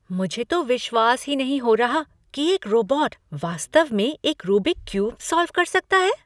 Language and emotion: Hindi, surprised